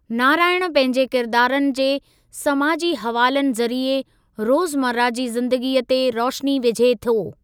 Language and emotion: Sindhi, neutral